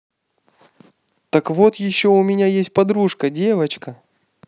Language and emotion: Russian, positive